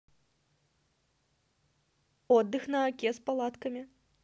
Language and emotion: Russian, neutral